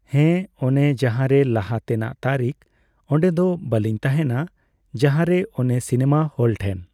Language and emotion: Santali, neutral